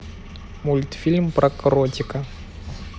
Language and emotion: Russian, neutral